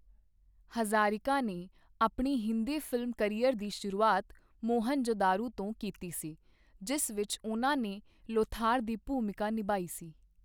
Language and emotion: Punjabi, neutral